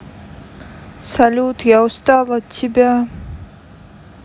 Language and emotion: Russian, sad